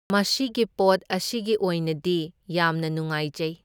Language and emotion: Manipuri, neutral